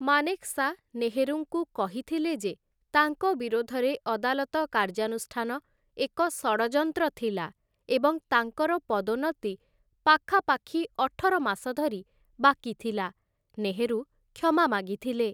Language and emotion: Odia, neutral